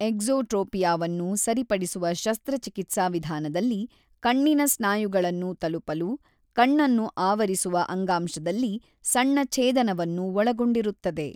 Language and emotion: Kannada, neutral